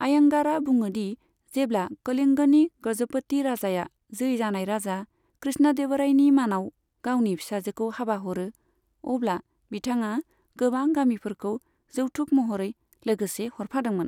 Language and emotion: Bodo, neutral